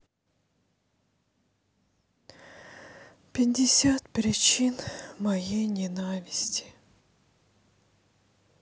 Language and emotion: Russian, sad